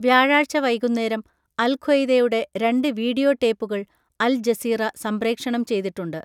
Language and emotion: Malayalam, neutral